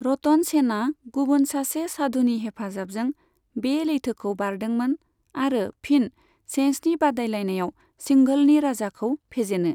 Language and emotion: Bodo, neutral